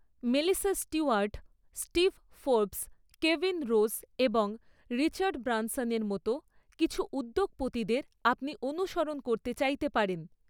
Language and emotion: Bengali, neutral